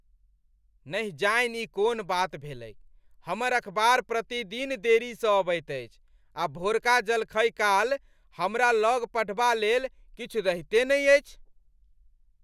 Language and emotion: Maithili, angry